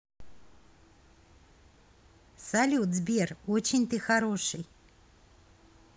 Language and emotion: Russian, positive